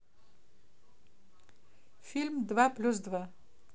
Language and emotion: Russian, neutral